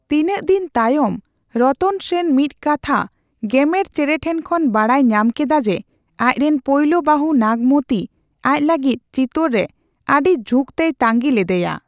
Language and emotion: Santali, neutral